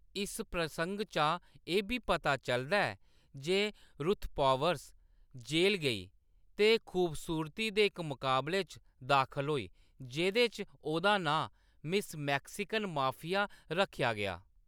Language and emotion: Dogri, neutral